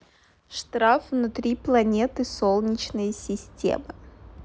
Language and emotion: Russian, neutral